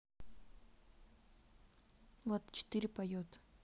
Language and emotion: Russian, neutral